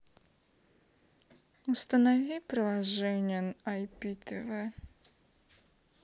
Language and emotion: Russian, sad